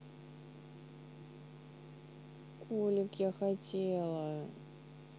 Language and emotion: Russian, neutral